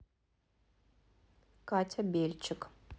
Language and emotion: Russian, neutral